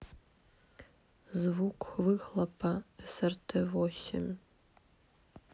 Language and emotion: Russian, neutral